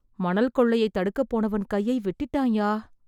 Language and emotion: Tamil, sad